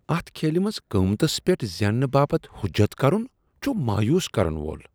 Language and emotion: Kashmiri, disgusted